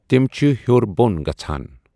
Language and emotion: Kashmiri, neutral